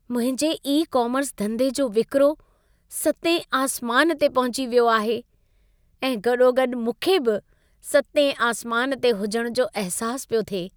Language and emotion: Sindhi, happy